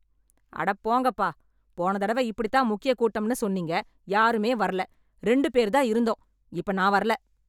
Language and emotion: Tamil, angry